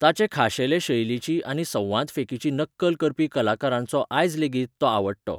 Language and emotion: Goan Konkani, neutral